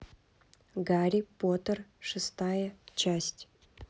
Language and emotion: Russian, neutral